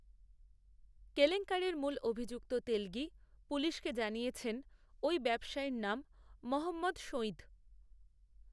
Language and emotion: Bengali, neutral